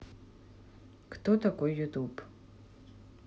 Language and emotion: Russian, neutral